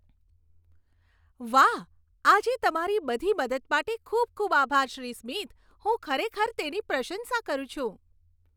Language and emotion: Gujarati, happy